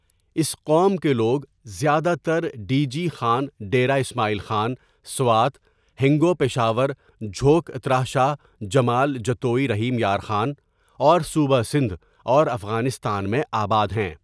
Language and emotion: Urdu, neutral